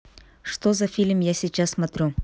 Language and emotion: Russian, neutral